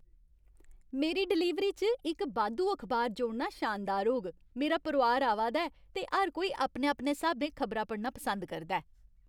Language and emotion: Dogri, happy